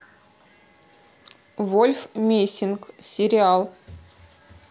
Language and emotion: Russian, neutral